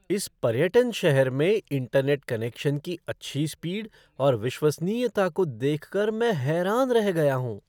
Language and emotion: Hindi, surprised